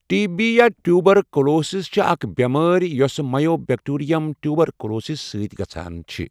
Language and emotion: Kashmiri, neutral